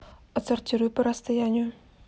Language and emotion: Russian, neutral